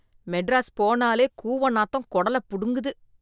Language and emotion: Tamil, disgusted